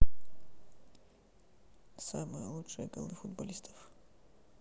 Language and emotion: Russian, sad